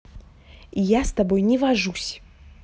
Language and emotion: Russian, angry